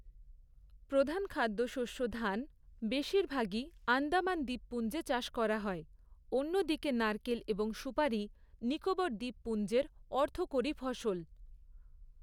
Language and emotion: Bengali, neutral